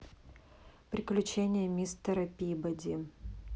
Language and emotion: Russian, neutral